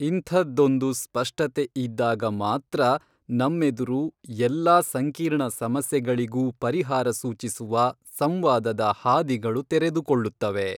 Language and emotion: Kannada, neutral